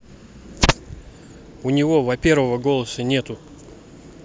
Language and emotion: Russian, neutral